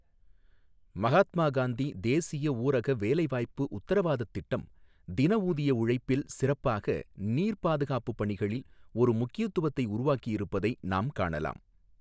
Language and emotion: Tamil, neutral